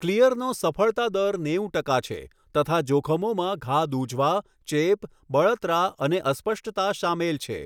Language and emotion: Gujarati, neutral